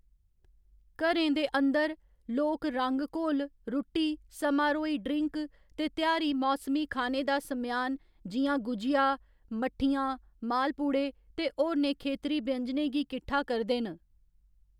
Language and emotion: Dogri, neutral